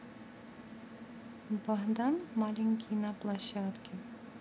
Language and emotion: Russian, neutral